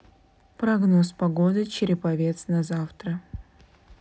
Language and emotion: Russian, neutral